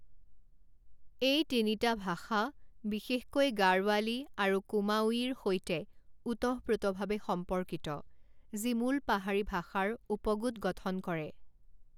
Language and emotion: Assamese, neutral